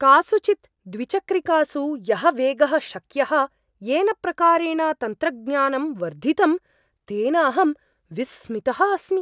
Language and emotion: Sanskrit, surprised